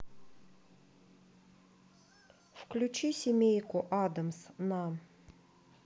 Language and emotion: Russian, neutral